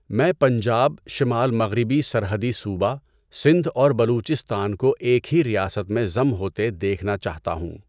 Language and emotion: Urdu, neutral